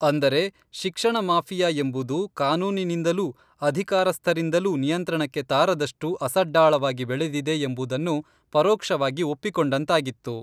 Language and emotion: Kannada, neutral